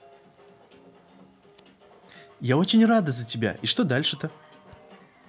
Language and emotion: Russian, positive